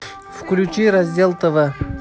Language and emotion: Russian, neutral